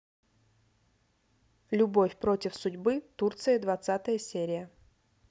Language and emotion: Russian, neutral